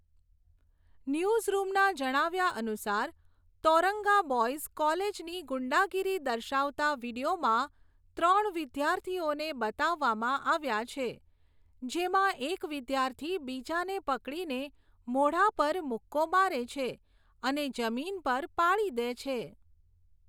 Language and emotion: Gujarati, neutral